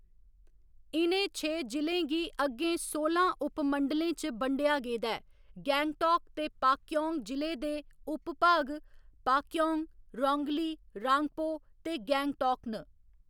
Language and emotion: Dogri, neutral